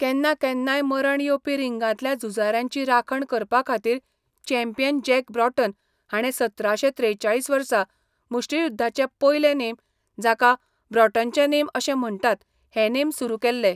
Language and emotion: Goan Konkani, neutral